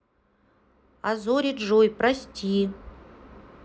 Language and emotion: Russian, neutral